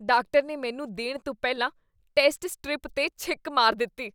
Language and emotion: Punjabi, disgusted